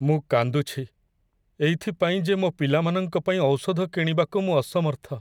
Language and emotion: Odia, sad